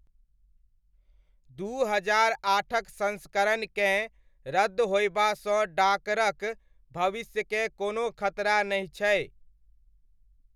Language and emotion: Maithili, neutral